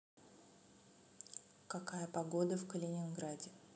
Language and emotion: Russian, neutral